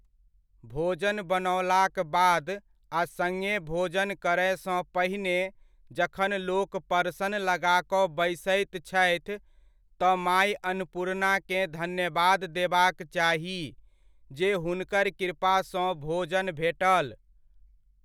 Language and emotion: Maithili, neutral